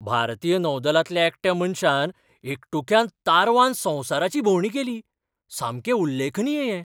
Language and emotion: Goan Konkani, surprised